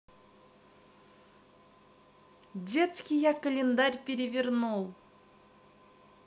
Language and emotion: Russian, neutral